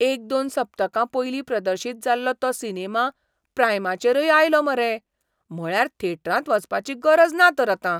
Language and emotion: Goan Konkani, surprised